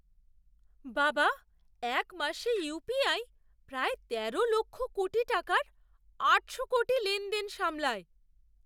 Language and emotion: Bengali, surprised